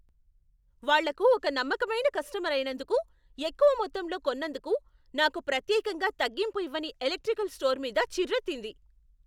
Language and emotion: Telugu, angry